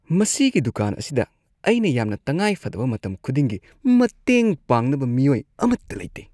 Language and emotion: Manipuri, disgusted